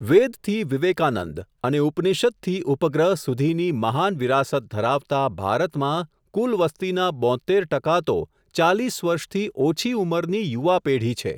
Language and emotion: Gujarati, neutral